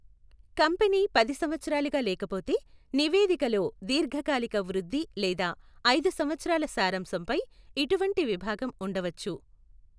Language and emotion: Telugu, neutral